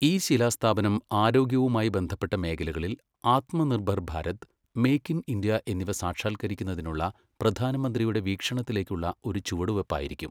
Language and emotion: Malayalam, neutral